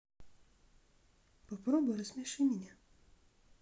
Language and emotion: Russian, sad